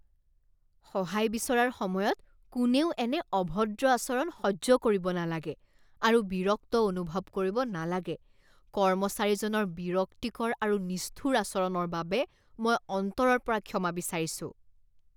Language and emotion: Assamese, disgusted